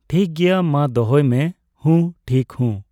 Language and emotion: Santali, neutral